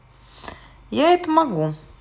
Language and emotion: Russian, neutral